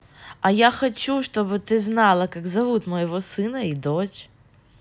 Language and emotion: Russian, positive